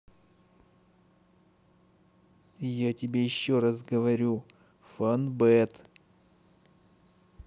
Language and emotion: Russian, angry